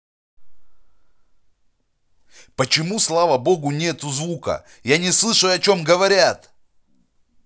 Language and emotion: Russian, angry